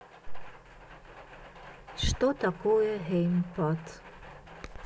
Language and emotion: Russian, neutral